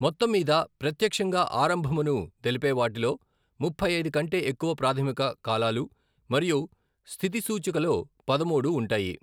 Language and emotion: Telugu, neutral